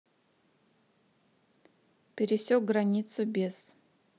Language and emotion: Russian, neutral